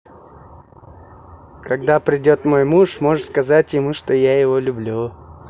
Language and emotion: Russian, positive